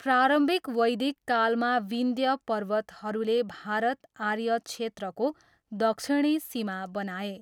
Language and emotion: Nepali, neutral